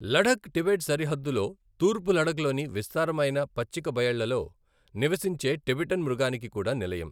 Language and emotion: Telugu, neutral